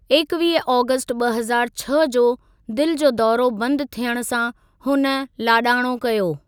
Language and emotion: Sindhi, neutral